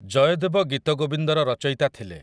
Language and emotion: Odia, neutral